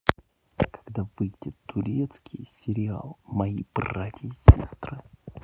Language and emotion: Russian, neutral